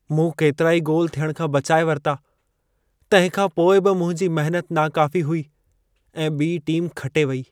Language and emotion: Sindhi, sad